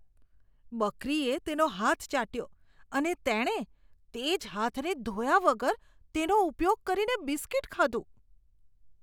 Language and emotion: Gujarati, disgusted